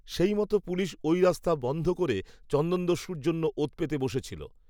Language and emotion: Bengali, neutral